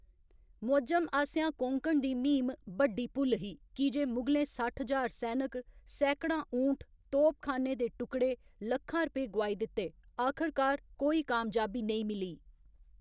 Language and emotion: Dogri, neutral